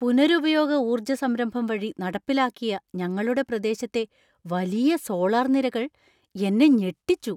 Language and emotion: Malayalam, surprised